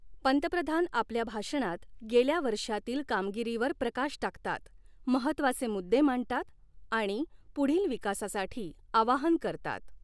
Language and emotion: Marathi, neutral